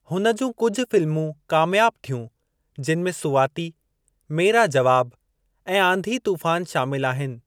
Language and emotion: Sindhi, neutral